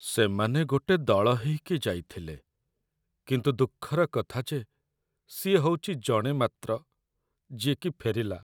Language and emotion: Odia, sad